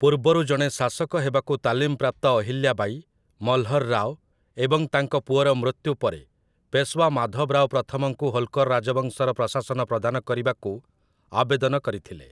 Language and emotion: Odia, neutral